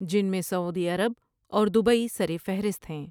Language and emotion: Urdu, neutral